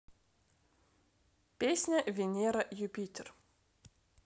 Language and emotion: Russian, neutral